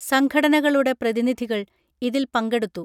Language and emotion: Malayalam, neutral